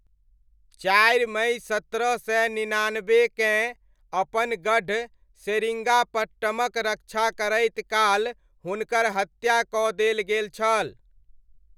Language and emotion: Maithili, neutral